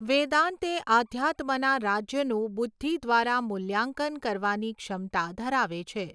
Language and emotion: Gujarati, neutral